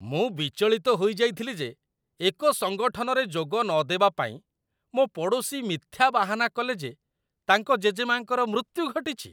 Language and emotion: Odia, disgusted